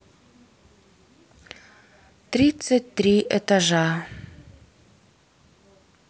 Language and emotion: Russian, sad